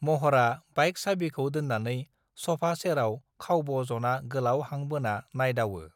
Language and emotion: Bodo, neutral